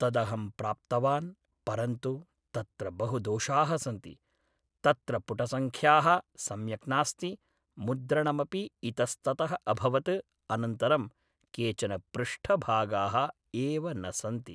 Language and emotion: Sanskrit, neutral